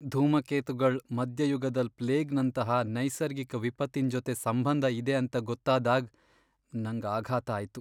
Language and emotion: Kannada, sad